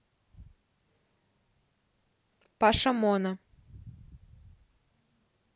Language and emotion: Russian, neutral